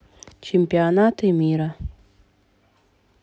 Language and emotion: Russian, neutral